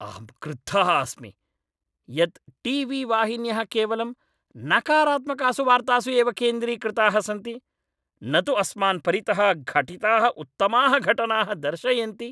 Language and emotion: Sanskrit, angry